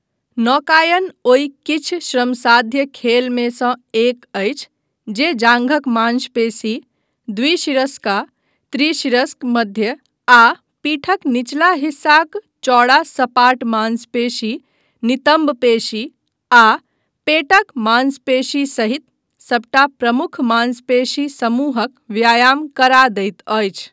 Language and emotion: Maithili, neutral